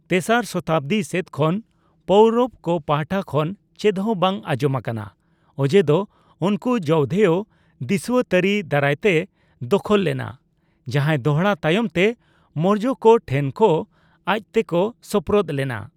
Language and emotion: Santali, neutral